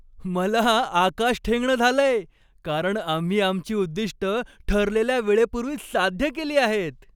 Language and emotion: Marathi, happy